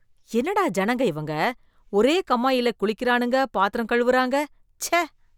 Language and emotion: Tamil, disgusted